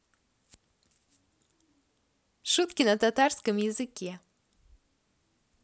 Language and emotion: Russian, positive